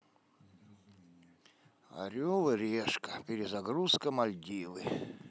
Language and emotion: Russian, sad